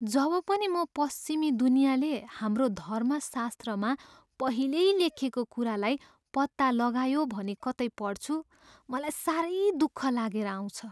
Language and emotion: Nepali, sad